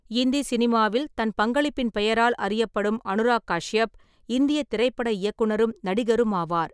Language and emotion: Tamil, neutral